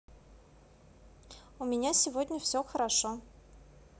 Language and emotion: Russian, positive